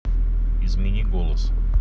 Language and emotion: Russian, neutral